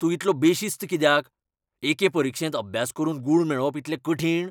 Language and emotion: Goan Konkani, angry